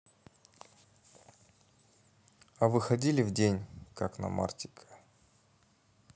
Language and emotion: Russian, neutral